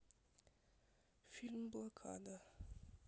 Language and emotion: Russian, neutral